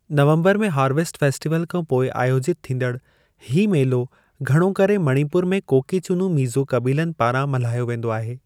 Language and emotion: Sindhi, neutral